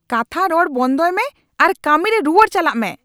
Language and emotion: Santali, angry